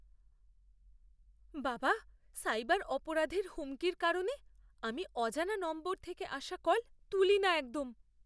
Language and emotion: Bengali, fearful